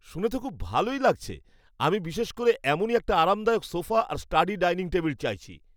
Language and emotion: Bengali, happy